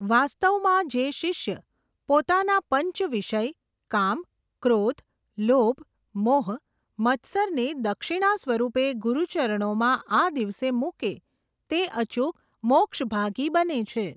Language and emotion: Gujarati, neutral